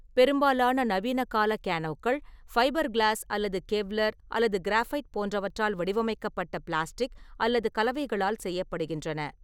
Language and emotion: Tamil, neutral